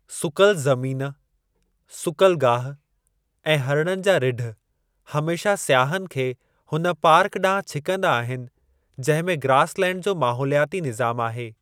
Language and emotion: Sindhi, neutral